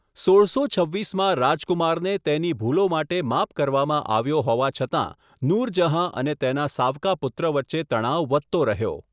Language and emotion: Gujarati, neutral